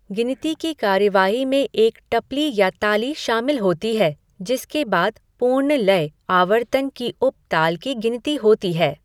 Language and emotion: Hindi, neutral